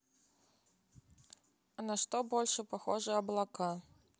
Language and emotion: Russian, neutral